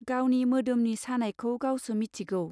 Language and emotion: Bodo, neutral